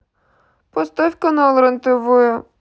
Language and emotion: Russian, sad